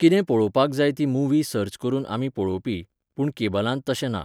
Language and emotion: Goan Konkani, neutral